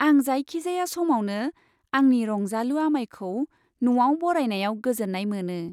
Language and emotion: Bodo, happy